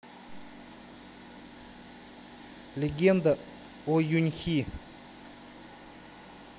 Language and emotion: Russian, neutral